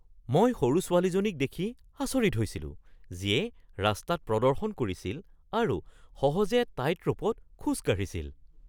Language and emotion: Assamese, surprised